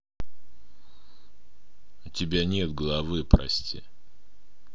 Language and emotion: Russian, neutral